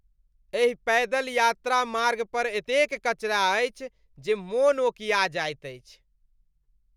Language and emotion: Maithili, disgusted